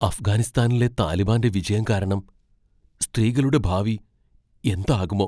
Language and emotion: Malayalam, fearful